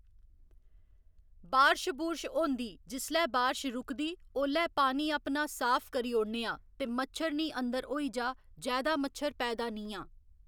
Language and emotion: Dogri, neutral